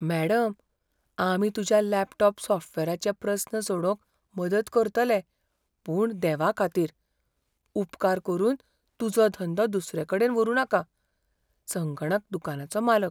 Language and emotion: Goan Konkani, fearful